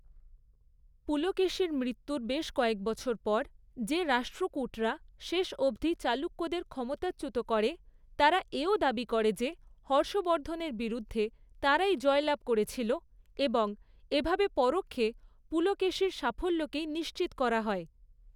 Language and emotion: Bengali, neutral